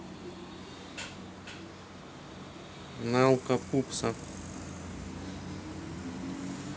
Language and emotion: Russian, neutral